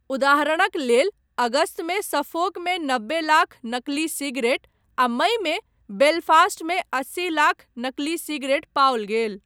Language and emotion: Maithili, neutral